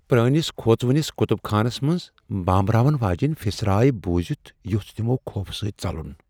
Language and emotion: Kashmiri, fearful